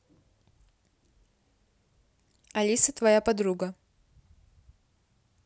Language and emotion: Russian, neutral